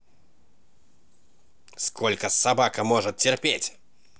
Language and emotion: Russian, angry